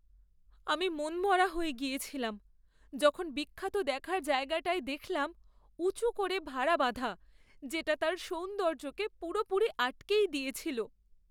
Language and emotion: Bengali, sad